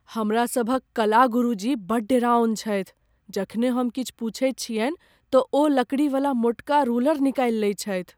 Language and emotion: Maithili, fearful